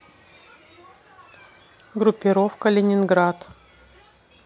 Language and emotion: Russian, neutral